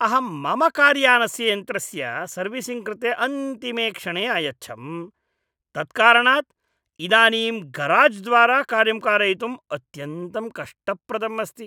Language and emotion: Sanskrit, disgusted